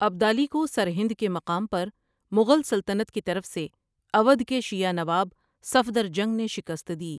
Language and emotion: Urdu, neutral